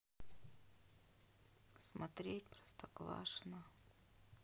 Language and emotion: Russian, sad